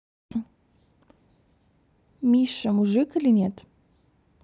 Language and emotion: Russian, neutral